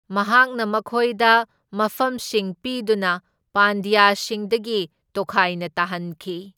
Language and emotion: Manipuri, neutral